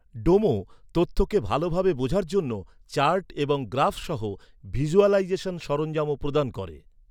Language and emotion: Bengali, neutral